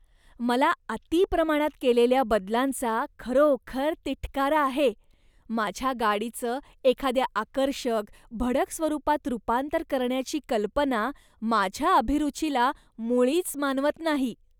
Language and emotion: Marathi, disgusted